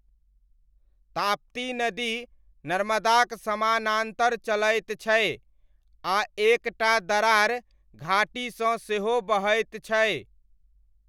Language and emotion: Maithili, neutral